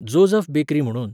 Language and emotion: Goan Konkani, neutral